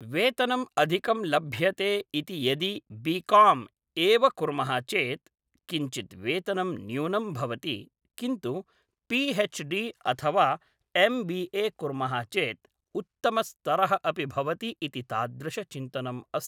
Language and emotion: Sanskrit, neutral